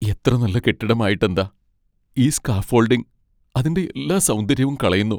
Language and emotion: Malayalam, sad